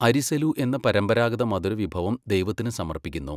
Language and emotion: Malayalam, neutral